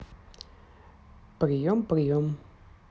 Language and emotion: Russian, neutral